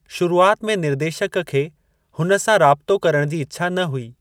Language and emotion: Sindhi, neutral